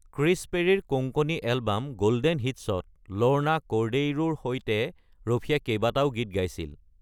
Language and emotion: Assamese, neutral